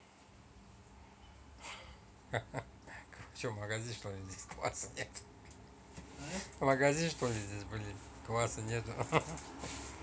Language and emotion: Russian, positive